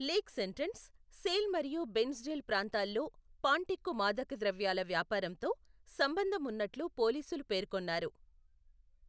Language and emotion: Telugu, neutral